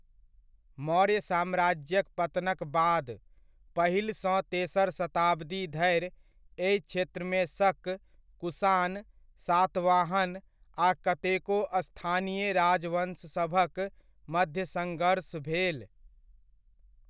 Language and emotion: Maithili, neutral